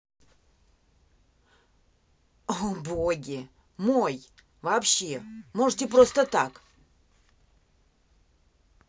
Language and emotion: Russian, angry